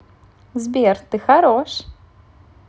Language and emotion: Russian, positive